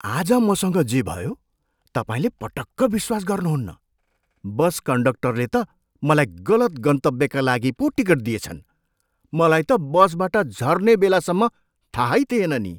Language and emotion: Nepali, surprised